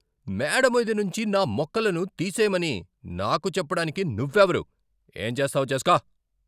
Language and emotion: Telugu, angry